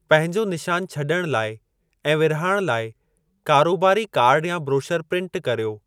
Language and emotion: Sindhi, neutral